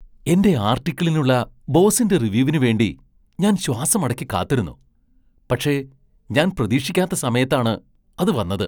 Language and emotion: Malayalam, surprised